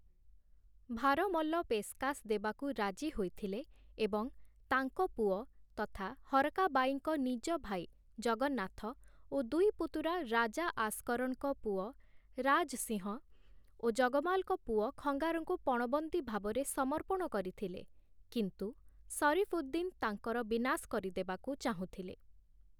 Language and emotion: Odia, neutral